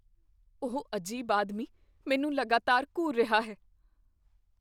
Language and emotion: Punjabi, fearful